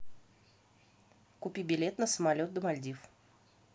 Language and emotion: Russian, neutral